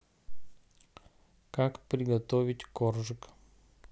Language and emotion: Russian, neutral